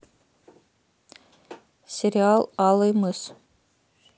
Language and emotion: Russian, neutral